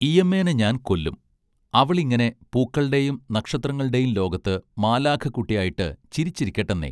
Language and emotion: Malayalam, neutral